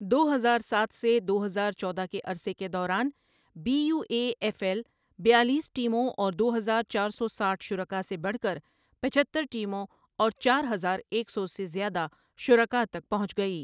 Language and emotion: Urdu, neutral